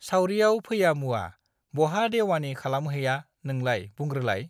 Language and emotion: Bodo, neutral